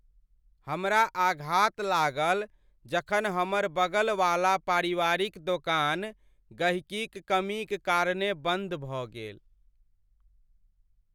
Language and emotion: Maithili, sad